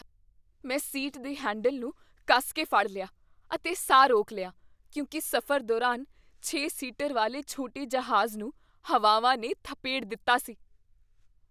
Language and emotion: Punjabi, fearful